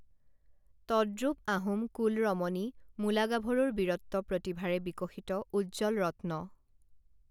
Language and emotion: Assamese, neutral